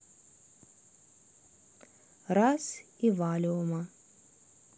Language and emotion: Russian, neutral